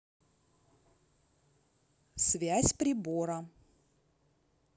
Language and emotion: Russian, neutral